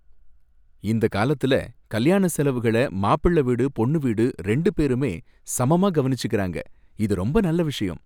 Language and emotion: Tamil, happy